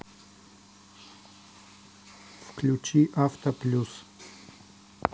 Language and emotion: Russian, neutral